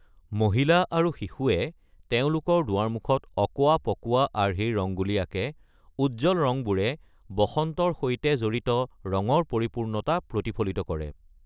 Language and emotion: Assamese, neutral